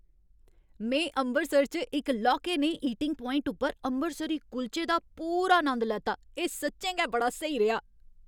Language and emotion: Dogri, happy